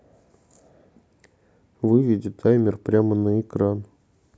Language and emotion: Russian, neutral